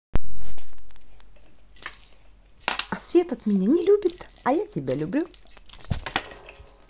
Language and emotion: Russian, positive